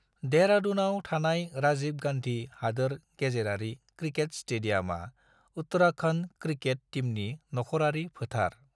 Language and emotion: Bodo, neutral